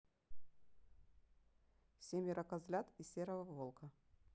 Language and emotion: Russian, neutral